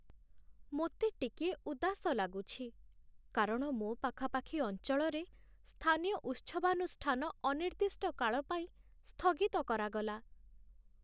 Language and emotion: Odia, sad